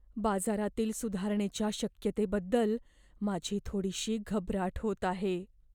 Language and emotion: Marathi, fearful